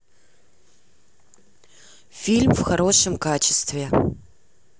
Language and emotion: Russian, neutral